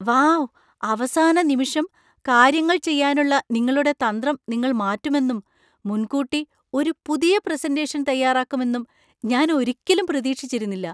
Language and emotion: Malayalam, surprised